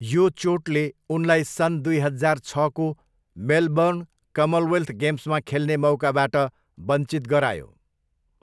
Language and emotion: Nepali, neutral